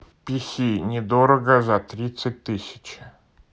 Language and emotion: Russian, neutral